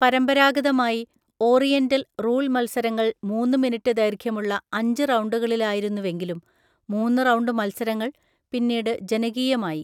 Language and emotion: Malayalam, neutral